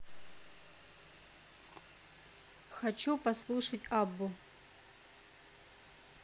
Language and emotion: Russian, neutral